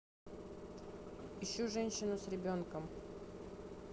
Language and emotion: Russian, neutral